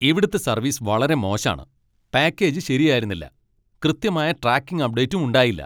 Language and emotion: Malayalam, angry